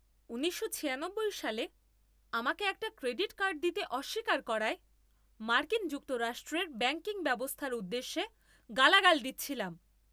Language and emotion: Bengali, angry